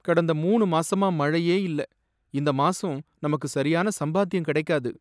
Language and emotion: Tamil, sad